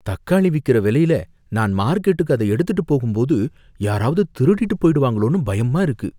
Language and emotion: Tamil, fearful